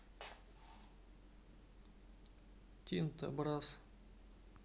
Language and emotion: Russian, sad